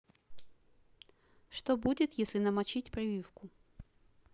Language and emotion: Russian, neutral